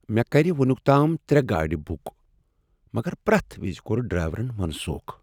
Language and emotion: Kashmiri, sad